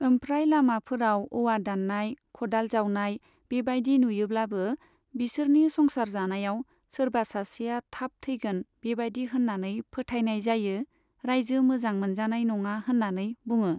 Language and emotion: Bodo, neutral